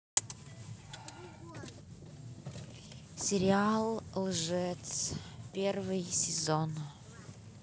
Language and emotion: Russian, neutral